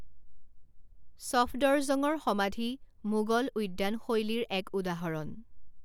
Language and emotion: Assamese, neutral